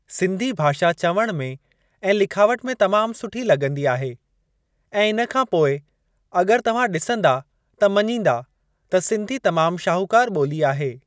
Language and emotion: Sindhi, neutral